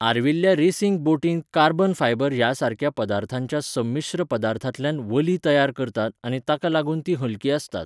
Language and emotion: Goan Konkani, neutral